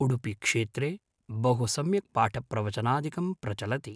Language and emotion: Sanskrit, neutral